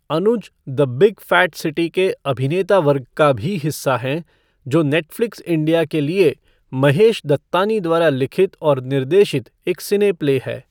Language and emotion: Hindi, neutral